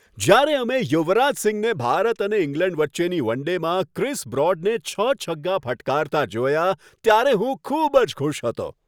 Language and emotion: Gujarati, happy